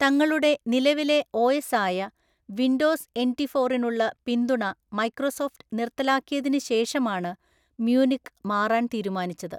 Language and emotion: Malayalam, neutral